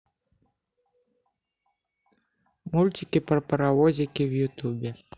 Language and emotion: Russian, neutral